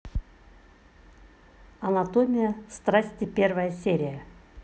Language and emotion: Russian, neutral